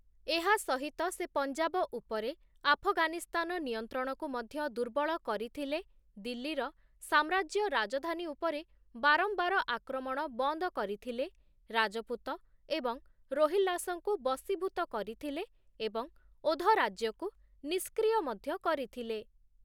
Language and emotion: Odia, neutral